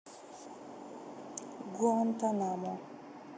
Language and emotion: Russian, neutral